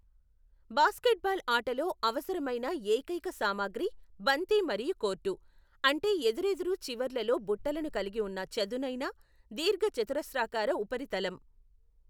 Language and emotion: Telugu, neutral